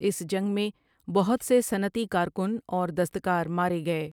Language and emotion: Urdu, neutral